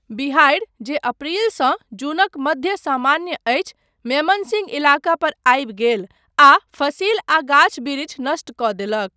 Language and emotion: Maithili, neutral